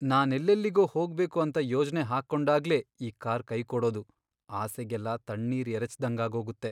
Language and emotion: Kannada, sad